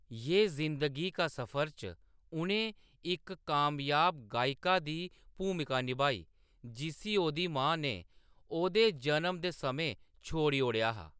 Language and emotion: Dogri, neutral